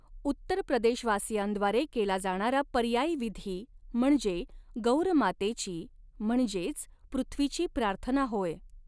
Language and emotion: Marathi, neutral